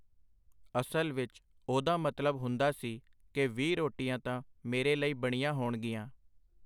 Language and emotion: Punjabi, neutral